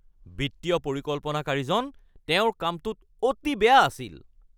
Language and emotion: Assamese, angry